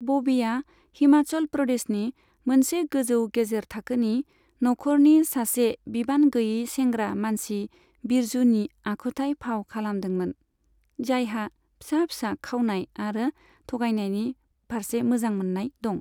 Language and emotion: Bodo, neutral